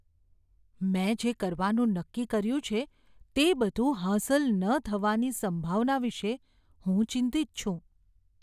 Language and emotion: Gujarati, fearful